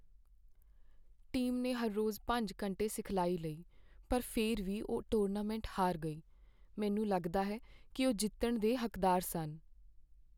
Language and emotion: Punjabi, sad